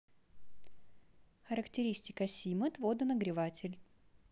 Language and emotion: Russian, neutral